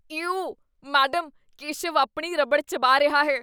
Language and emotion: Punjabi, disgusted